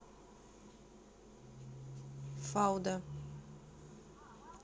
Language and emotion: Russian, neutral